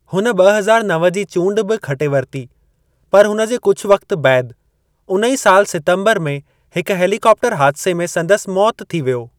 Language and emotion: Sindhi, neutral